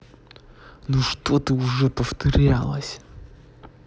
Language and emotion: Russian, angry